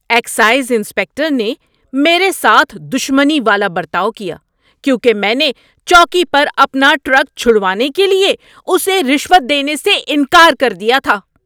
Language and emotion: Urdu, angry